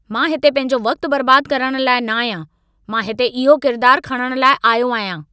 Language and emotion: Sindhi, angry